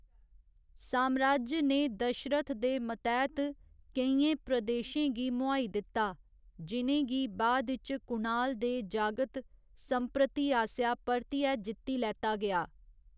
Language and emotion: Dogri, neutral